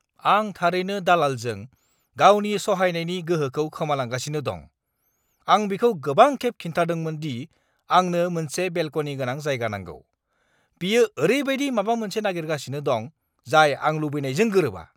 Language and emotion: Bodo, angry